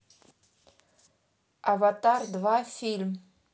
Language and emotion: Russian, neutral